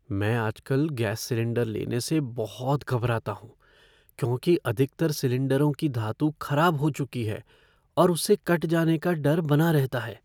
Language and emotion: Hindi, fearful